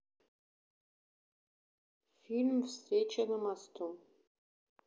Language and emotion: Russian, neutral